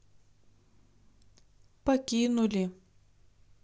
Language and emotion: Russian, sad